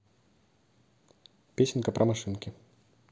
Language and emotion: Russian, neutral